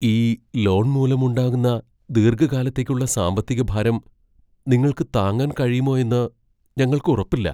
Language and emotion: Malayalam, fearful